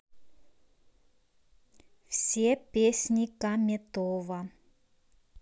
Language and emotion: Russian, neutral